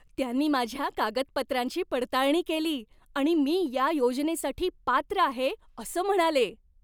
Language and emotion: Marathi, happy